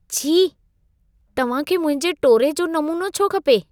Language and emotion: Sindhi, disgusted